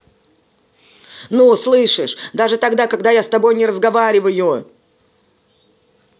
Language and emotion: Russian, angry